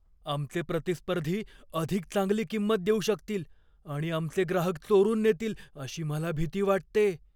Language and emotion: Marathi, fearful